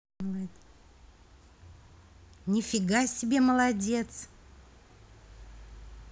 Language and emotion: Russian, positive